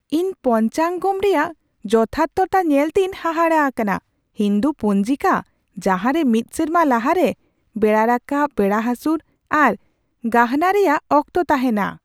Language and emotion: Santali, surprised